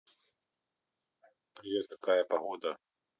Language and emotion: Russian, neutral